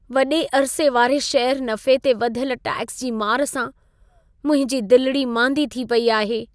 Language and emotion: Sindhi, sad